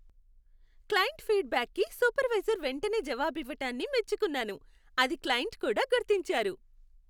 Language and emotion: Telugu, happy